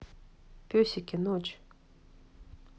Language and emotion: Russian, neutral